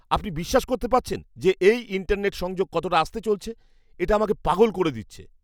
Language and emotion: Bengali, angry